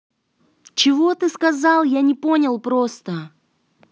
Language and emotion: Russian, angry